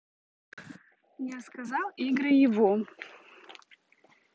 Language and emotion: Russian, neutral